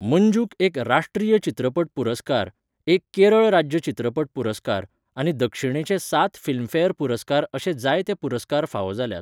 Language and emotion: Goan Konkani, neutral